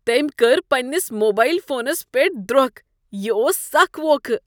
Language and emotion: Kashmiri, disgusted